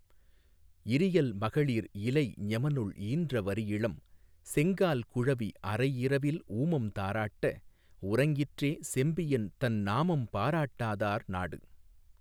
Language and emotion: Tamil, neutral